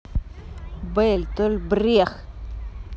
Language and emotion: Russian, angry